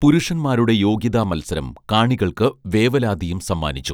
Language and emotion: Malayalam, neutral